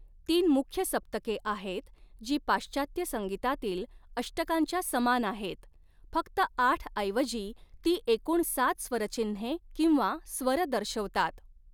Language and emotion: Marathi, neutral